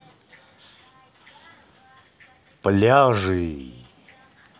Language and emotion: Russian, positive